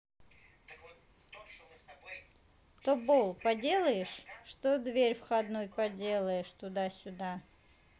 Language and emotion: Russian, neutral